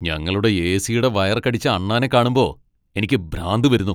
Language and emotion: Malayalam, angry